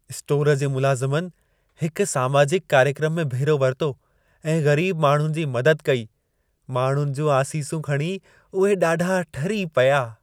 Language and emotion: Sindhi, happy